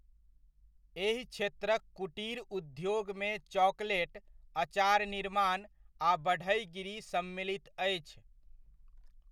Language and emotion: Maithili, neutral